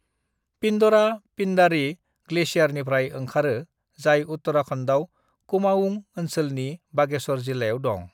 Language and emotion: Bodo, neutral